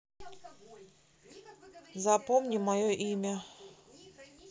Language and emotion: Russian, neutral